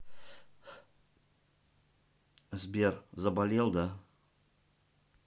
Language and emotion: Russian, neutral